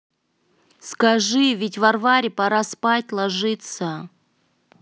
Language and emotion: Russian, neutral